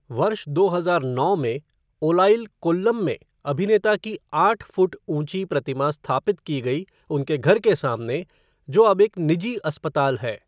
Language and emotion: Hindi, neutral